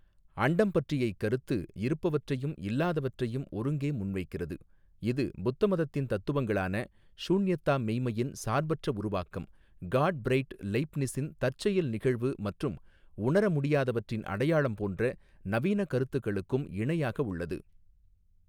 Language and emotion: Tamil, neutral